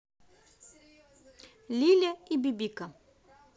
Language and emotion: Russian, positive